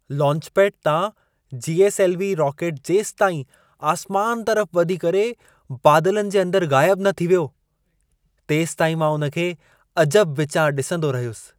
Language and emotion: Sindhi, surprised